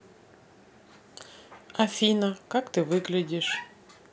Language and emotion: Russian, neutral